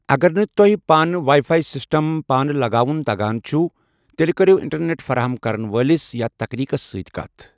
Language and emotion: Kashmiri, neutral